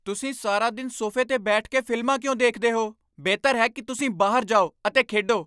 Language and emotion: Punjabi, angry